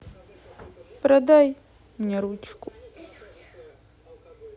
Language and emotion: Russian, sad